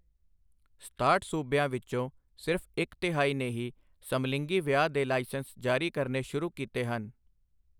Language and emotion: Punjabi, neutral